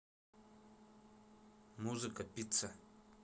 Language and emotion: Russian, neutral